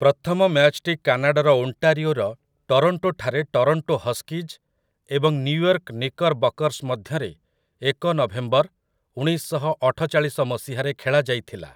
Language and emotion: Odia, neutral